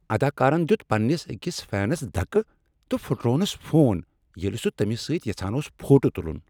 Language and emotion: Kashmiri, angry